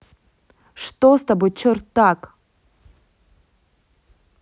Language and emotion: Russian, angry